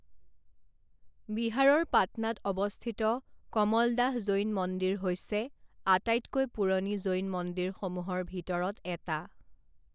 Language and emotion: Assamese, neutral